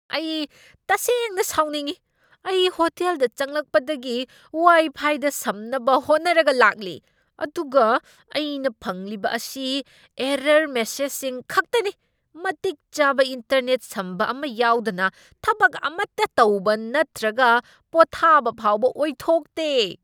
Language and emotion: Manipuri, angry